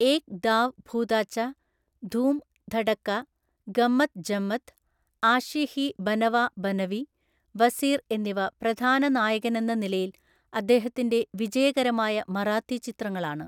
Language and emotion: Malayalam, neutral